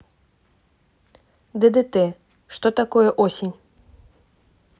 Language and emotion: Russian, neutral